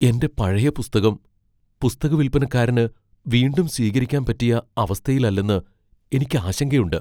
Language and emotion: Malayalam, fearful